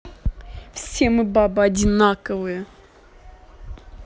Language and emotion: Russian, angry